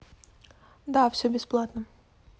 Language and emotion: Russian, neutral